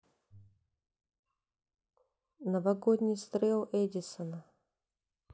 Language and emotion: Russian, neutral